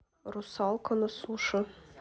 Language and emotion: Russian, neutral